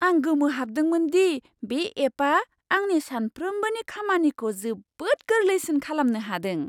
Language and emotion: Bodo, surprised